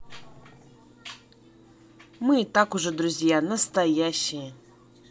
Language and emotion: Russian, positive